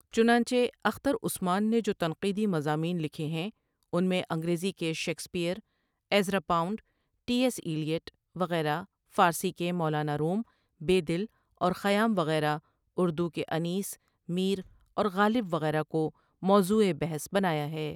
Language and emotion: Urdu, neutral